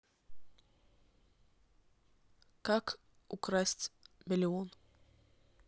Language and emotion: Russian, neutral